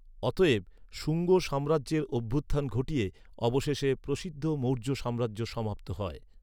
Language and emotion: Bengali, neutral